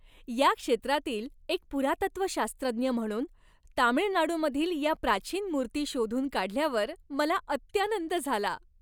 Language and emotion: Marathi, happy